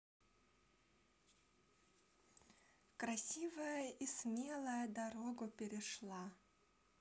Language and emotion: Russian, positive